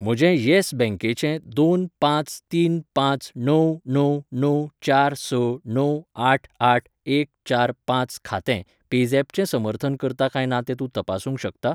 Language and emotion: Goan Konkani, neutral